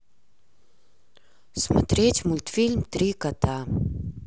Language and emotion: Russian, sad